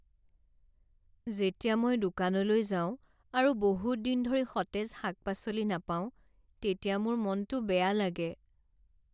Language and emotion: Assamese, sad